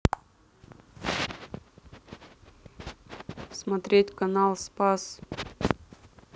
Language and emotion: Russian, neutral